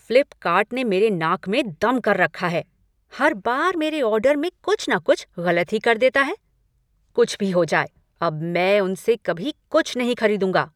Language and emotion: Hindi, angry